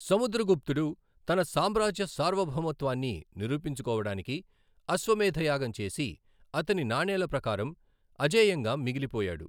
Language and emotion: Telugu, neutral